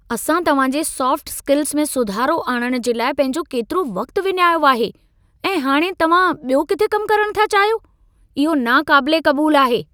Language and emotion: Sindhi, angry